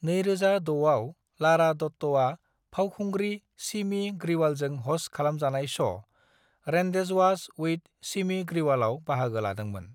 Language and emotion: Bodo, neutral